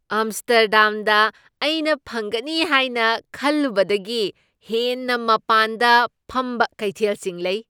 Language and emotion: Manipuri, surprised